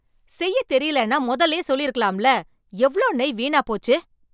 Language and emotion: Tamil, angry